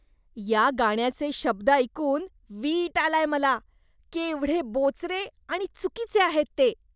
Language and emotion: Marathi, disgusted